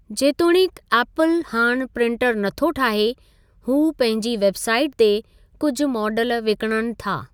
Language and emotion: Sindhi, neutral